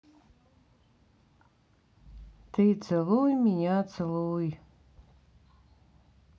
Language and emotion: Russian, sad